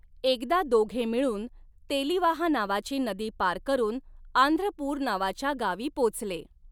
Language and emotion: Marathi, neutral